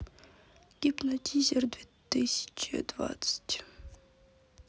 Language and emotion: Russian, sad